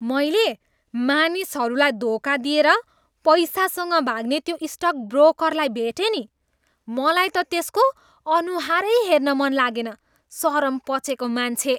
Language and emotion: Nepali, disgusted